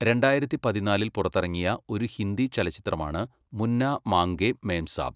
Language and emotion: Malayalam, neutral